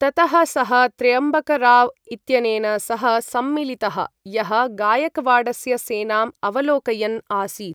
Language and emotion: Sanskrit, neutral